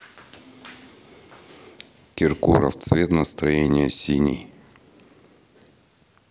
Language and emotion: Russian, neutral